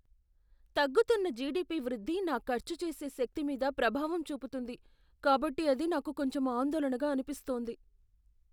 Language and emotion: Telugu, fearful